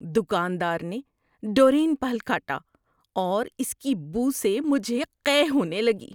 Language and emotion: Urdu, disgusted